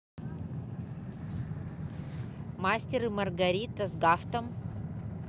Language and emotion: Russian, neutral